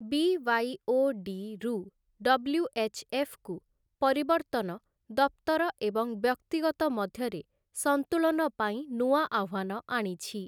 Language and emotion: Odia, neutral